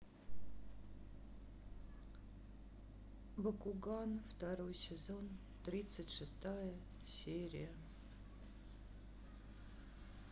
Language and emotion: Russian, sad